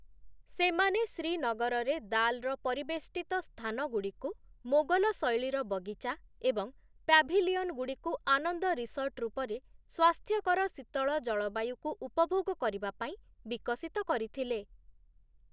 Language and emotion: Odia, neutral